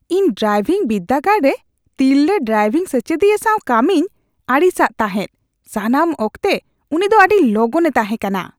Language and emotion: Santali, disgusted